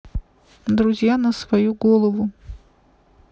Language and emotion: Russian, neutral